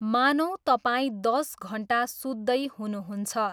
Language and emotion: Nepali, neutral